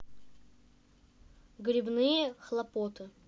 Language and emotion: Russian, neutral